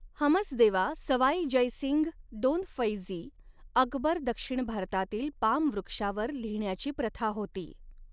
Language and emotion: Marathi, neutral